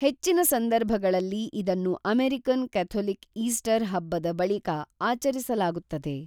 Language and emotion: Kannada, neutral